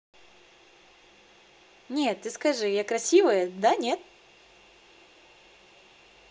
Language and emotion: Russian, positive